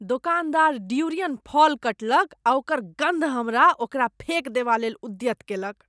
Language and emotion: Maithili, disgusted